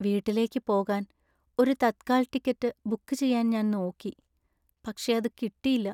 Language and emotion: Malayalam, sad